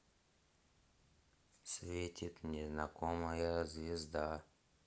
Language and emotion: Russian, sad